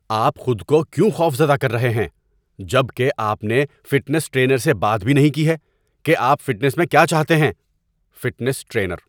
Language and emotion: Urdu, angry